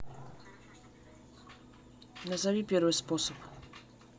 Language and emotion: Russian, neutral